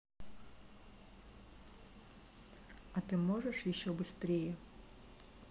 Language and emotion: Russian, neutral